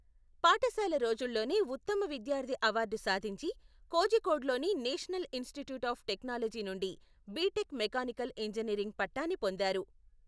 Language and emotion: Telugu, neutral